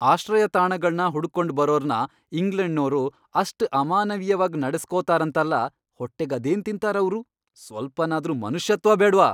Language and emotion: Kannada, angry